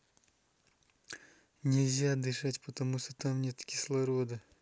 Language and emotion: Russian, neutral